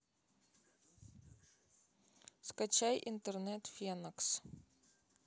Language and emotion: Russian, neutral